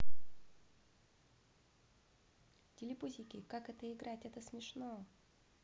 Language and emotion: Russian, neutral